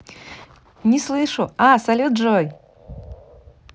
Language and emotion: Russian, positive